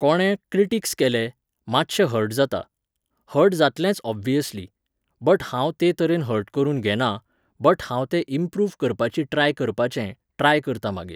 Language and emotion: Goan Konkani, neutral